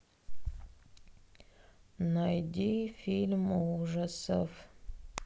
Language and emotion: Russian, sad